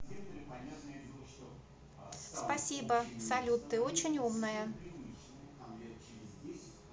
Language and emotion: Russian, positive